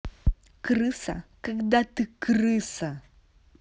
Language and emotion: Russian, angry